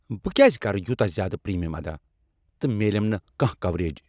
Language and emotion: Kashmiri, angry